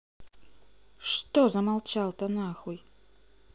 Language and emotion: Russian, angry